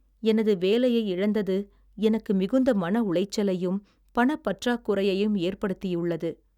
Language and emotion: Tamil, sad